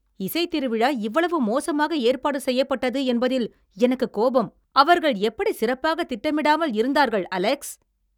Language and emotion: Tamil, angry